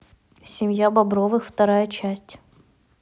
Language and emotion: Russian, neutral